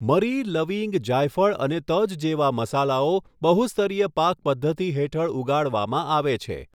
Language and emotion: Gujarati, neutral